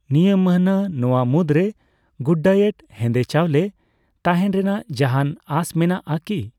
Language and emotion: Santali, neutral